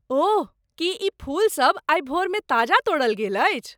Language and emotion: Maithili, surprised